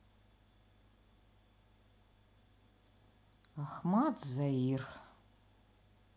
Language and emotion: Russian, neutral